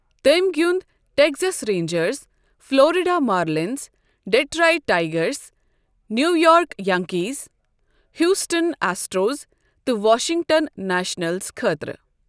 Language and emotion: Kashmiri, neutral